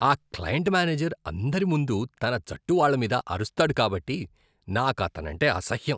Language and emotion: Telugu, disgusted